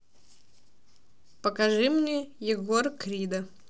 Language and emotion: Russian, neutral